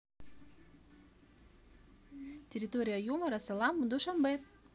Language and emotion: Russian, positive